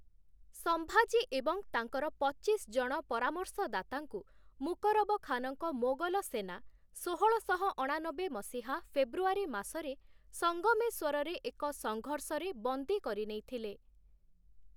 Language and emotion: Odia, neutral